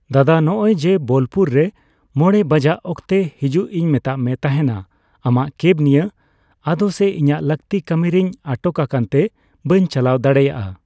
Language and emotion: Santali, neutral